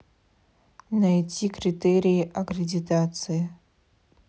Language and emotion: Russian, neutral